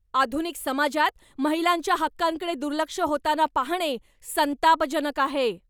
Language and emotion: Marathi, angry